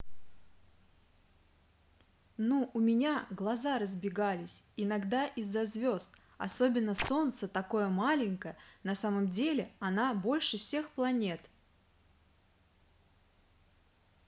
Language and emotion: Russian, positive